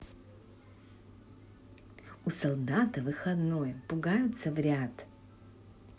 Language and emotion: Russian, neutral